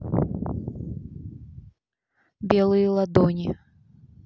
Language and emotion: Russian, neutral